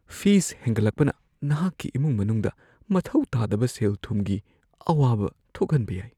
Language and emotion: Manipuri, fearful